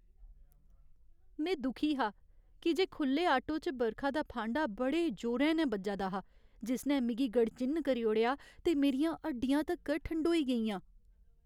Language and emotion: Dogri, sad